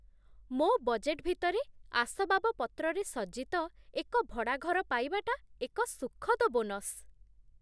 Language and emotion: Odia, surprised